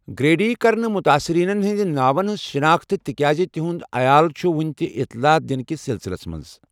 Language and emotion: Kashmiri, neutral